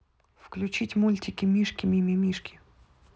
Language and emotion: Russian, neutral